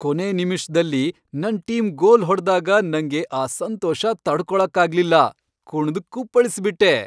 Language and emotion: Kannada, happy